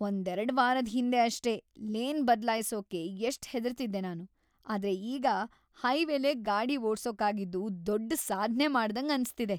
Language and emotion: Kannada, happy